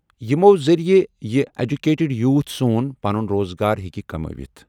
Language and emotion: Kashmiri, neutral